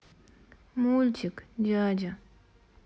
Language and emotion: Russian, sad